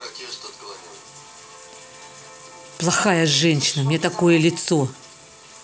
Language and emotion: Russian, angry